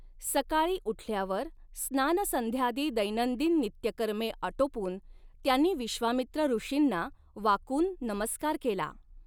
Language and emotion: Marathi, neutral